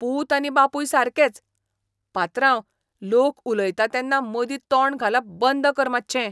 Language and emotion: Goan Konkani, disgusted